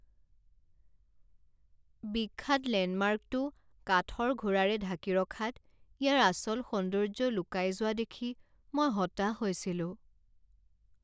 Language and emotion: Assamese, sad